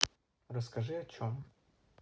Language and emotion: Russian, neutral